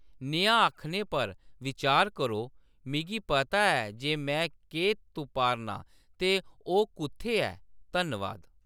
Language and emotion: Dogri, neutral